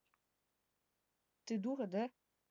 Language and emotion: Russian, angry